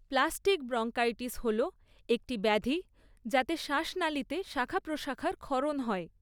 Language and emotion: Bengali, neutral